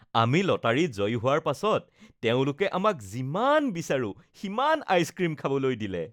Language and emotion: Assamese, happy